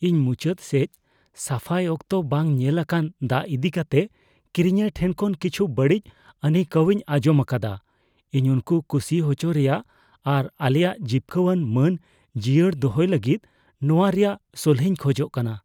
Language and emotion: Santali, fearful